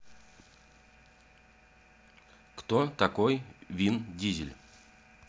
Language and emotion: Russian, neutral